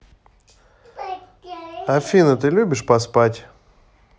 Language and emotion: Russian, neutral